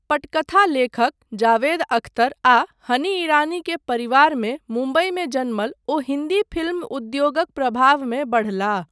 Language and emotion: Maithili, neutral